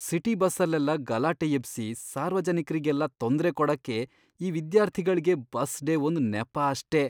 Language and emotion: Kannada, disgusted